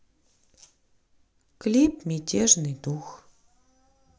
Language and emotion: Russian, neutral